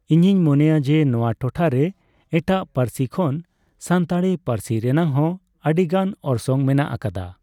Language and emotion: Santali, neutral